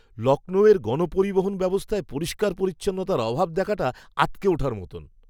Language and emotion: Bengali, disgusted